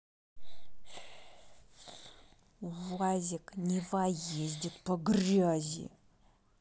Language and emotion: Russian, angry